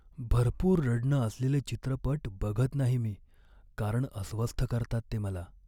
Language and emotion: Marathi, sad